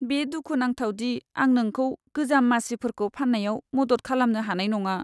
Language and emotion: Bodo, sad